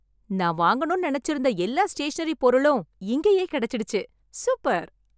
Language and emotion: Tamil, happy